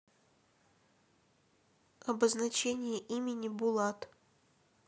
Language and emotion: Russian, neutral